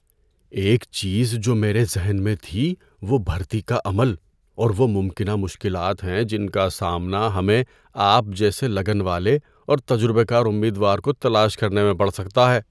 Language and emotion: Urdu, fearful